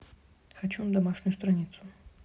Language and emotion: Russian, neutral